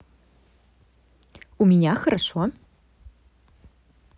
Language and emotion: Russian, positive